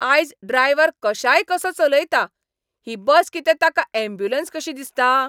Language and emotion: Goan Konkani, angry